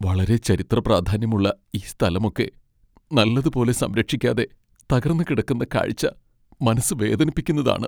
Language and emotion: Malayalam, sad